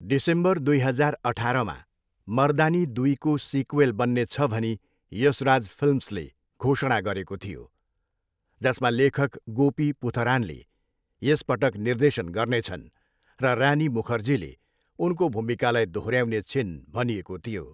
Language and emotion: Nepali, neutral